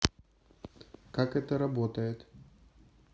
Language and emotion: Russian, neutral